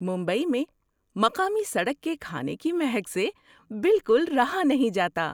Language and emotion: Urdu, surprised